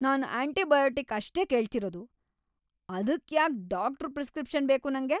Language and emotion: Kannada, angry